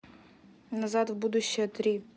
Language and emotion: Russian, neutral